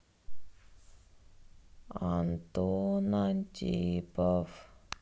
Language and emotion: Russian, sad